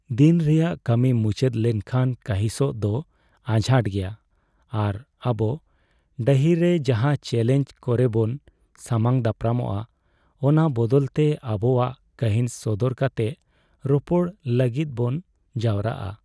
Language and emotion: Santali, sad